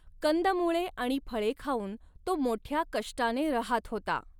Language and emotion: Marathi, neutral